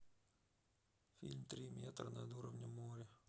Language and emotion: Russian, sad